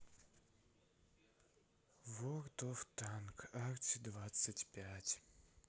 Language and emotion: Russian, sad